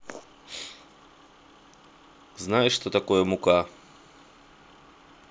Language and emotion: Russian, neutral